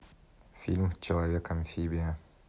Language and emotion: Russian, neutral